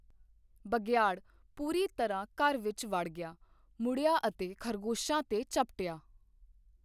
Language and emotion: Punjabi, neutral